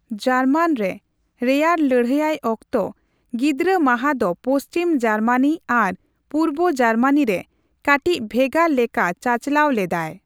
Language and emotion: Santali, neutral